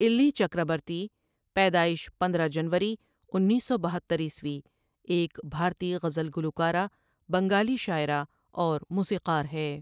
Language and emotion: Urdu, neutral